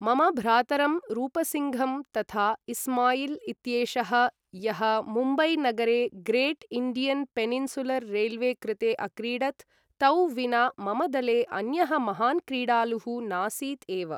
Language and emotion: Sanskrit, neutral